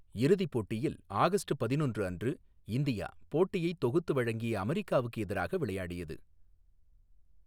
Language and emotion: Tamil, neutral